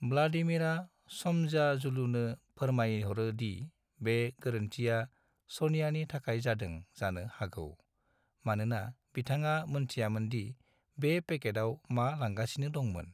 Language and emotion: Bodo, neutral